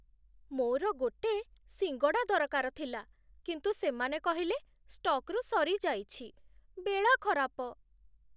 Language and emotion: Odia, sad